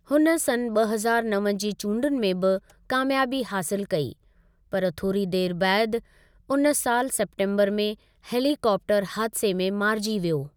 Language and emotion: Sindhi, neutral